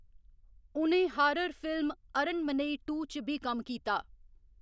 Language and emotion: Dogri, neutral